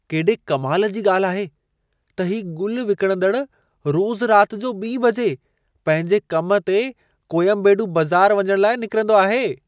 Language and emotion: Sindhi, surprised